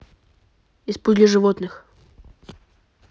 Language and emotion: Russian, neutral